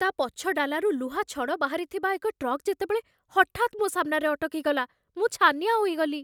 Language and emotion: Odia, fearful